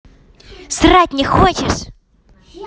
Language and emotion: Russian, angry